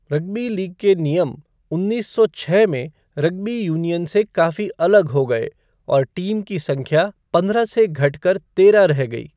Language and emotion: Hindi, neutral